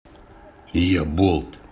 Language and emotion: Russian, neutral